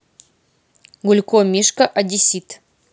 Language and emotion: Russian, neutral